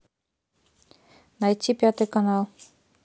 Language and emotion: Russian, neutral